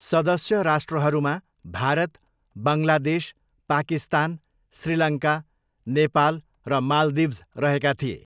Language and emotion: Nepali, neutral